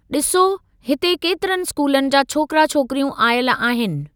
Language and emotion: Sindhi, neutral